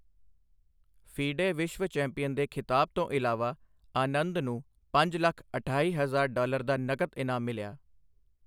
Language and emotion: Punjabi, neutral